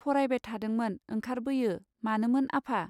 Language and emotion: Bodo, neutral